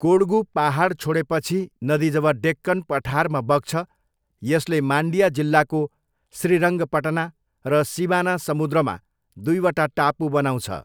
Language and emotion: Nepali, neutral